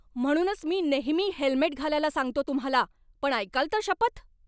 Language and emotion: Marathi, angry